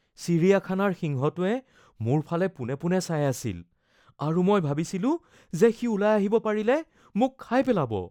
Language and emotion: Assamese, fearful